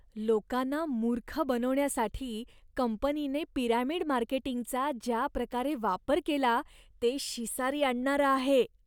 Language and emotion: Marathi, disgusted